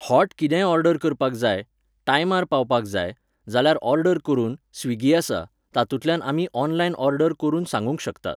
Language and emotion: Goan Konkani, neutral